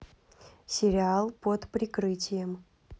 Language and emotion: Russian, neutral